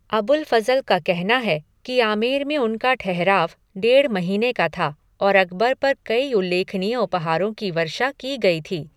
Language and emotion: Hindi, neutral